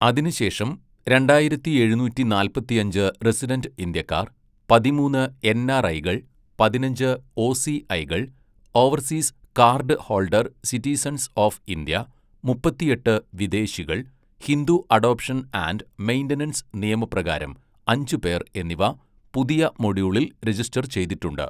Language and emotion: Malayalam, neutral